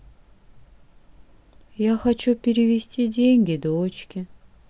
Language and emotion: Russian, sad